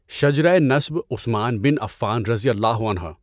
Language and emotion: Urdu, neutral